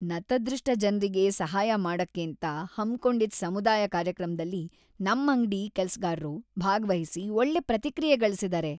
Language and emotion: Kannada, happy